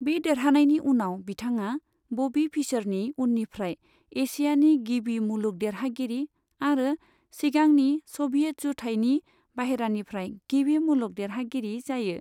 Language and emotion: Bodo, neutral